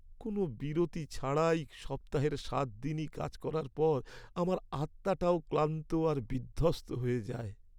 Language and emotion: Bengali, sad